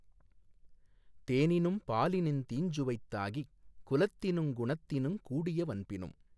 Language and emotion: Tamil, neutral